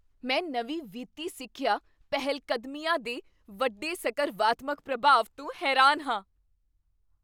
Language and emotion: Punjabi, surprised